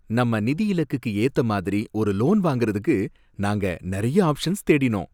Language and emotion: Tamil, happy